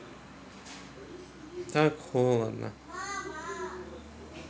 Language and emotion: Russian, sad